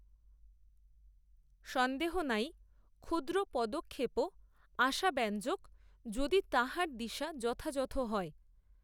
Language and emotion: Bengali, neutral